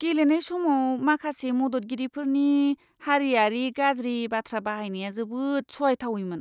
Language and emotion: Bodo, disgusted